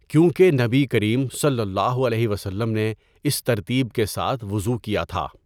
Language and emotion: Urdu, neutral